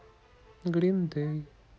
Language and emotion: Russian, sad